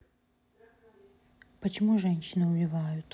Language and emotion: Russian, sad